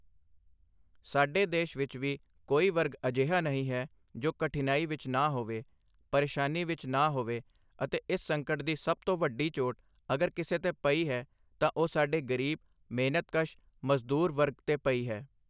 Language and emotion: Punjabi, neutral